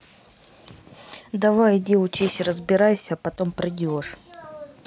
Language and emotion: Russian, neutral